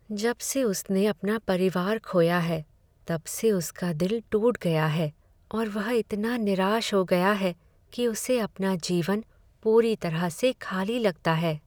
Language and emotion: Hindi, sad